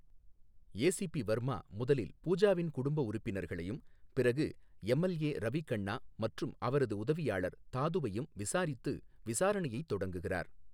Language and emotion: Tamil, neutral